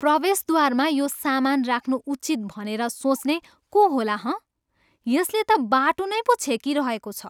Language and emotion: Nepali, disgusted